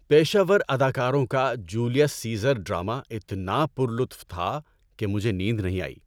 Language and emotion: Urdu, happy